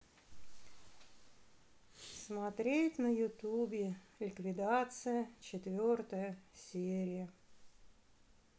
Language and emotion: Russian, sad